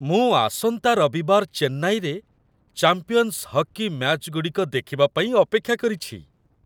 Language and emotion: Odia, happy